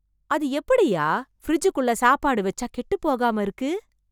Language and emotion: Tamil, surprised